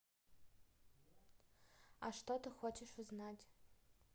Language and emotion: Russian, neutral